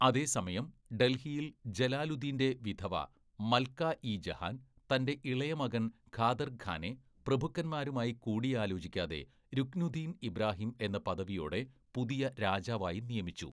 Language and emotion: Malayalam, neutral